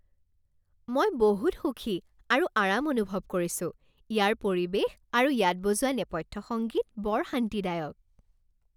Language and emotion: Assamese, happy